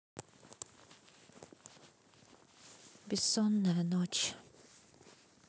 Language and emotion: Russian, sad